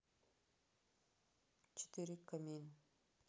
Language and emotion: Russian, neutral